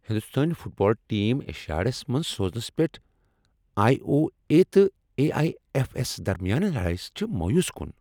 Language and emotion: Kashmiri, angry